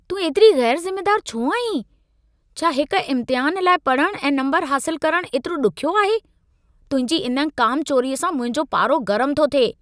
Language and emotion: Sindhi, angry